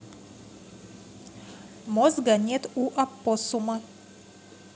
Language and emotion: Russian, neutral